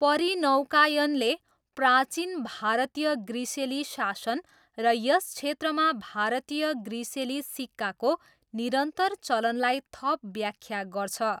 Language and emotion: Nepali, neutral